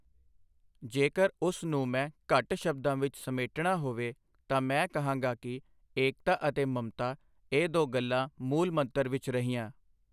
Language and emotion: Punjabi, neutral